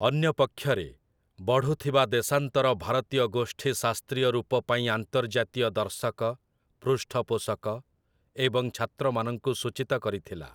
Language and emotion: Odia, neutral